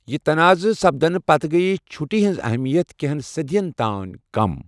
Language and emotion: Kashmiri, neutral